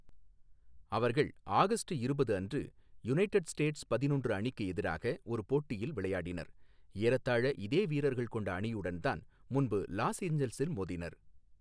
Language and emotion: Tamil, neutral